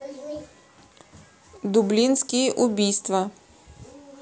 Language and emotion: Russian, neutral